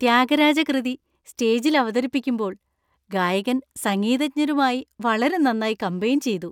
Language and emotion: Malayalam, happy